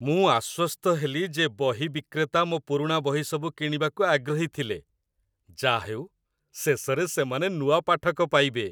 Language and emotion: Odia, happy